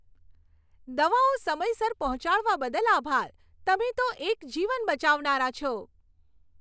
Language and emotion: Gujarati, happy